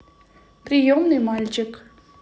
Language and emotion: Russian, neutral